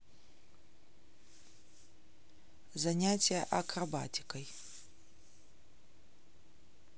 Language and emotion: Russian, neutral